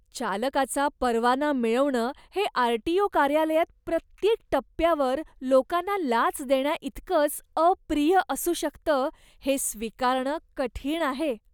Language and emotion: Marathi, disgusted